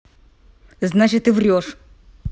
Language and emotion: Russian, angry